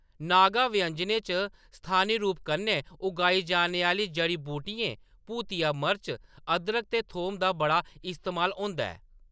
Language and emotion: Dogri, neutral